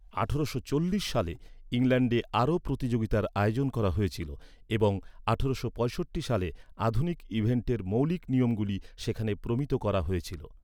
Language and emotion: Bengali, neutral